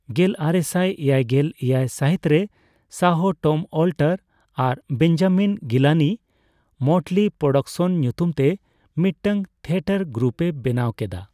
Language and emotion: Santali, neutral